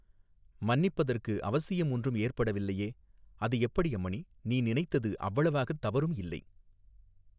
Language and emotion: Tamil, neutral